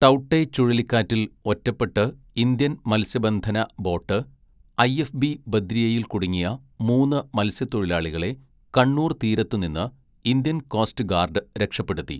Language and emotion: Malayalam, neutral